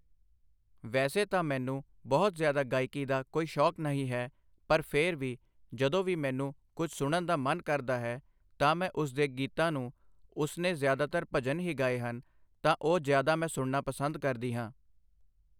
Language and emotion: Punjabi, neutral